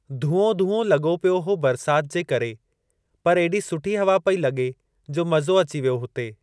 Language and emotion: Sindhi, neutral